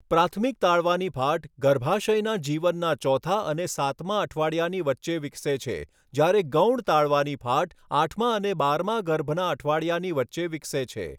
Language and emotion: Gujarati, neutral